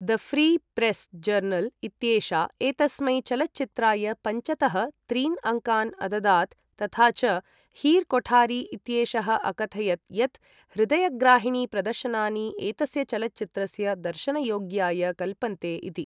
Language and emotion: Sanskrit, neutral